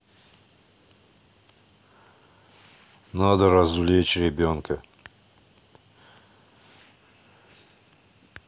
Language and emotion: Russian, neutral